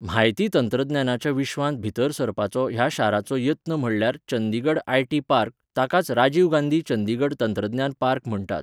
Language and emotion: Goan Konkani, neutral